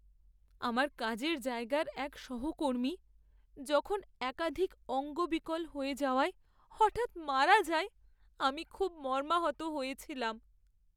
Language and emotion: Bengali, sad